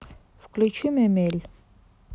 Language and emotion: Russian, neutral